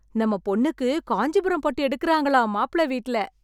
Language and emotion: Tamil, happy